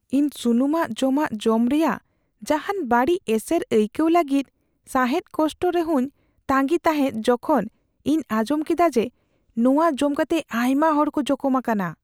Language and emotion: Santali, fearful